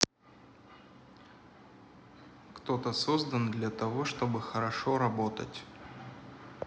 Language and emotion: Russian, neutral